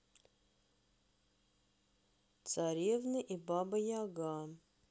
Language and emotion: Russian, neutral